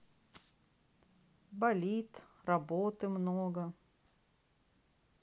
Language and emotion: Russian, sad